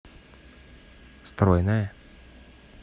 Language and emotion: Russian, positive